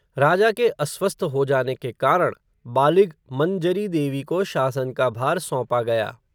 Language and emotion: Hindi, neutral